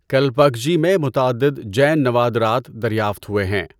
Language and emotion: Urdu, neutral